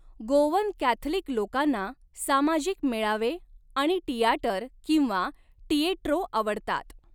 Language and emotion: Marathi, neutral